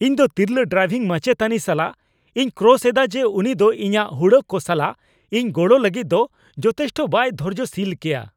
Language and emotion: Santali, angry